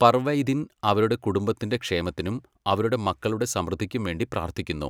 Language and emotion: Malayalam, neutral